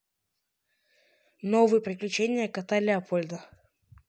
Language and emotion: Russian, neutral